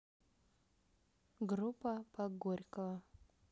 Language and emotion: Russian, neutral